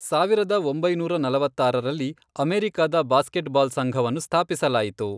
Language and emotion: Kannada, neutral